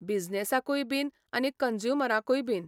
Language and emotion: Goan Konkani, neutral